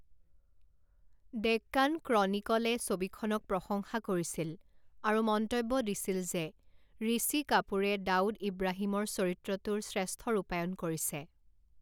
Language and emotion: Assamese, neutral